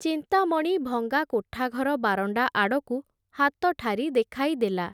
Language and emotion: Odia, neutral